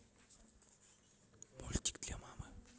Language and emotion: Russian, neutral